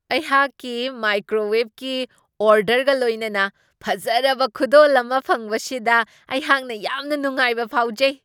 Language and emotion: Manipuri, surprised